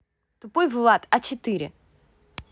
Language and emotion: Russian, angry